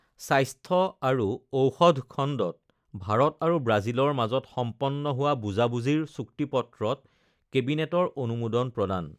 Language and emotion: Assamese, neutral